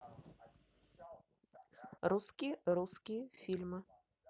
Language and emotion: Russian, neutral